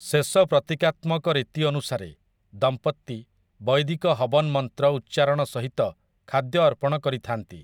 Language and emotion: Odia, neutral